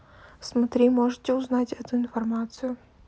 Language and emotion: Russian, neutral